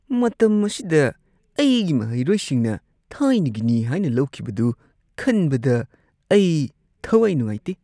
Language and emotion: Manipuri, disgusted